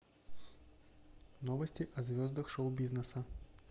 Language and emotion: Russian, neutral